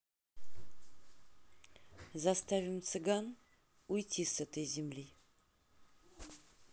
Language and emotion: Russian, neutral